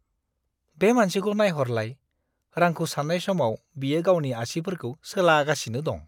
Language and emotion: Bodo, disgusted